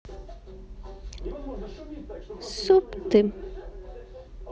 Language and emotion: Russian, neutral